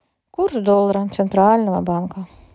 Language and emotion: Russian, neutral